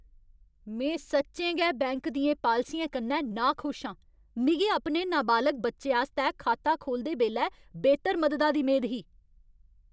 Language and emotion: Dogri, angry